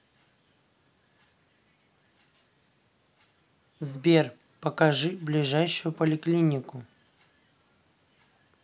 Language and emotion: Russian, neutral